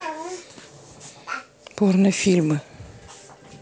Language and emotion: Russian, neutral